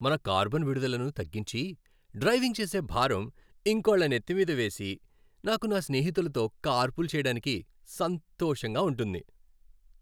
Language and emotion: Telugu, happy